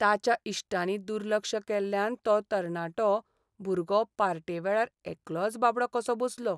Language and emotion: Goan Konkani, sad